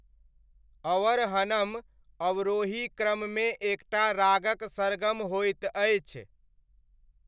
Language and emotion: Maithili, neutral